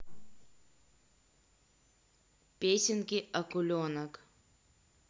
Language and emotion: Russian, neutral